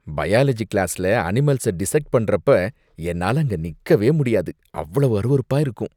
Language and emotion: Tamil, disgusted